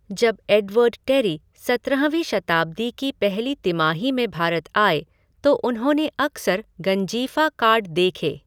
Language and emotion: Hindi, neutral